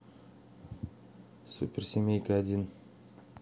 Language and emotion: Russian, neutral